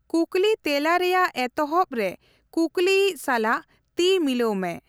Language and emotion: Santali, neutral